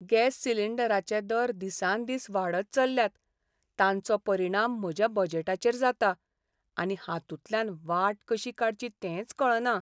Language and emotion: Goan Konkani, sad